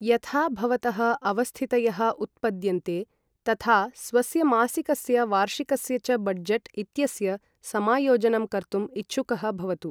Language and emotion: Sanskrit, neutral